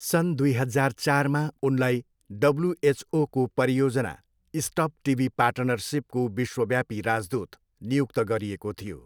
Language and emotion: Nepali, neutral